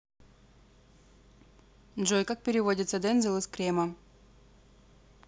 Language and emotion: Russian, neutral